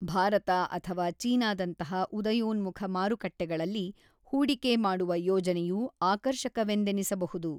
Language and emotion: Kannada, neutral